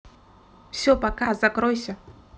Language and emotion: Russian, neutral